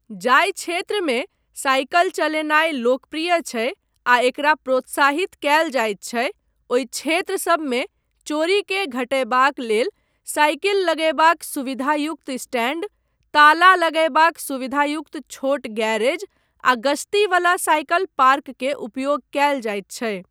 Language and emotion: Maithili, neutral